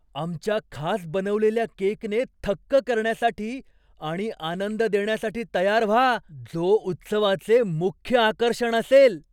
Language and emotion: Marathi, surprised